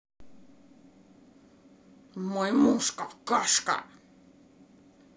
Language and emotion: Russian, angry